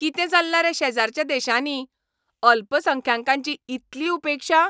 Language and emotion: Goan Konkani, angry